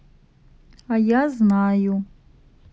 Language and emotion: Russian, neutral